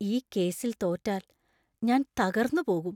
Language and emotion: Malayalam, fearful